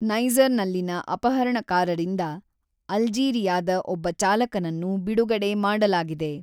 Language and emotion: Kannada, neutral